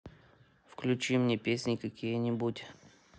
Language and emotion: Russian, neutral